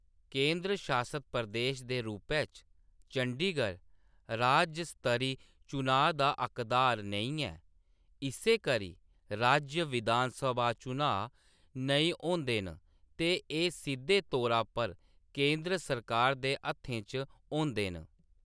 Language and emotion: Dogri, neutral